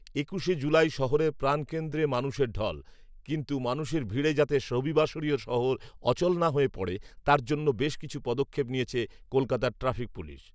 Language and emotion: Bengali, neutral